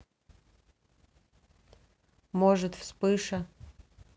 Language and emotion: Russian, neutral